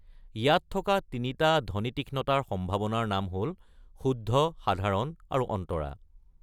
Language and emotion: Assamese, neutral